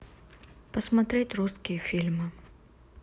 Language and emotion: Russian, neutral